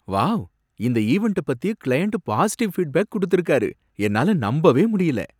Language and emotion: Tamil, surprised